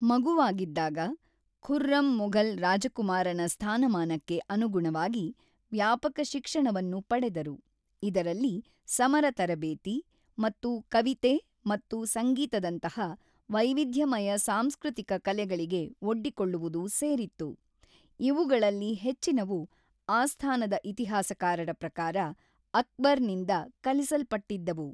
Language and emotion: Kannada, neutral